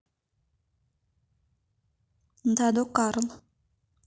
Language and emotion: Russian, neutral